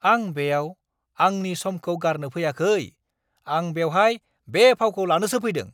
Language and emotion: Bodo, angry